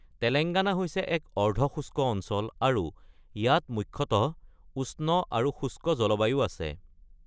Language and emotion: Assamese, neutral